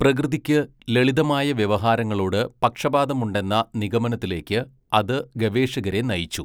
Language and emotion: Malayalam, neutral